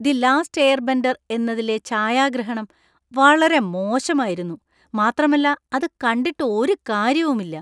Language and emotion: Malayalam, disgusted